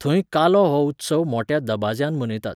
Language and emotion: Goan Konkani, neutral